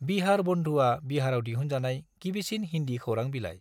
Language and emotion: Bodo, neutral